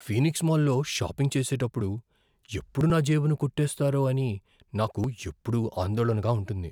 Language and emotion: Telugu, fearful